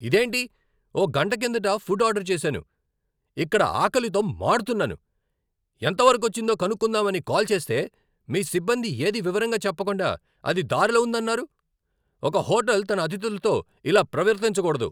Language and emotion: Telugu, angry